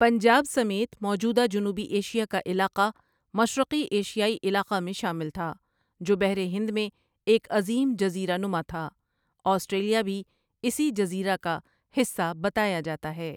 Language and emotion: Urdu, neutral